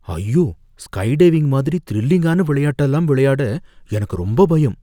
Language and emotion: Tamil, fearful